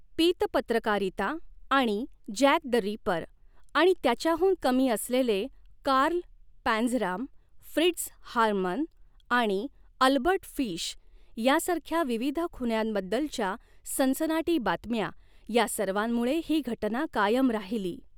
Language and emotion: Marathi, neutral